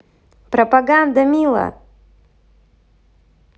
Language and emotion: Russian, positive